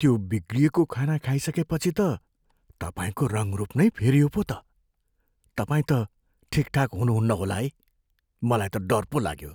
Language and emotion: Nepali, fearful